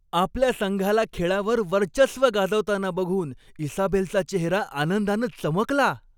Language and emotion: Marathi, happy